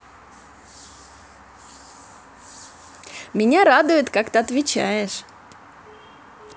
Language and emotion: Russian, positive